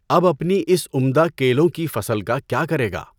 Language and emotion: Urdu, neutral